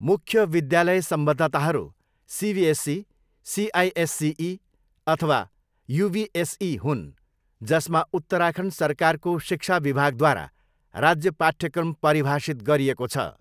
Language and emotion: Nepali, neutral